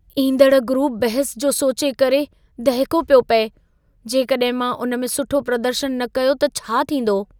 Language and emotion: Sindhi, fearful